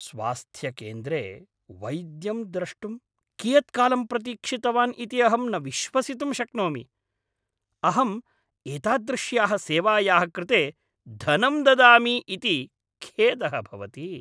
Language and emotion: Sanskrit, angry